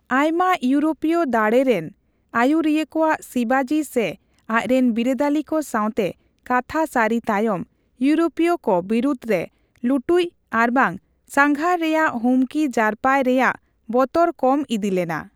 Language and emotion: Santali, neutral